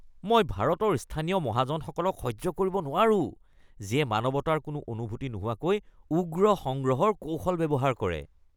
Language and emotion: Assamese, disgusted